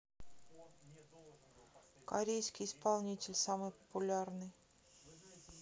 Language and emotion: Russian, neutral